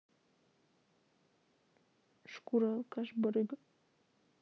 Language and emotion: Russian, neutral